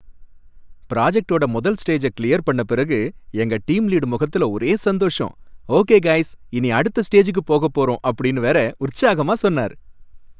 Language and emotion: Tamil, happy